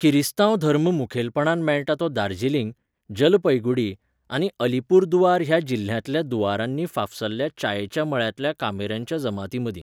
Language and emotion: Goan Konkani, neutral